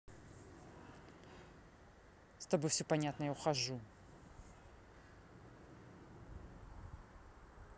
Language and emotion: Russian, angry